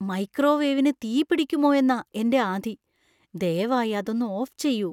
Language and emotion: Malayalam, fearful